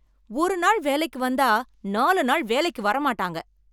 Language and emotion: Tamil, angry